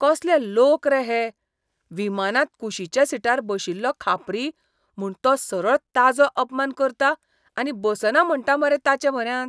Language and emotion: Goan Konkani, disgusted